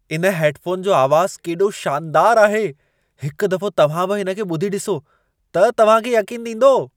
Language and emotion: Sindhi, surprised